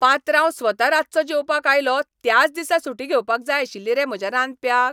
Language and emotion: Goan Konkani, angry